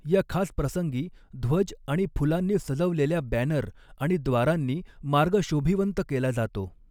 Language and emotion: Marathi, neutral